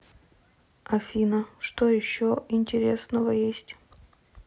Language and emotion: Russian, neutral